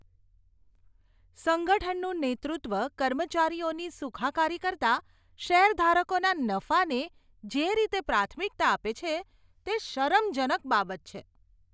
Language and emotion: Gujarati, disgusted